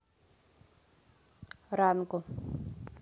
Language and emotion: Russian, neutral